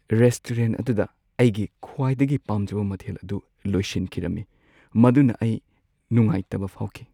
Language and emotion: Manipuri, sad